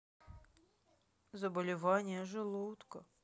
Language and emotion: Russian, sad